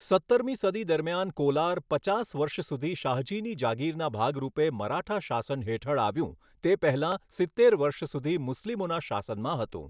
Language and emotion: Gujarati, neutral